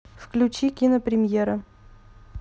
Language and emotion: Russian, neutral